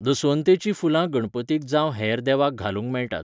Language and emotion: Goan Konkani, neutral